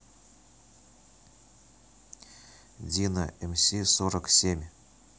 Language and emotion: Russian, neutral